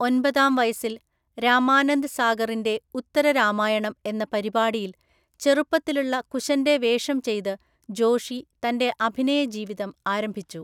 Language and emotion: Malayalam, neutral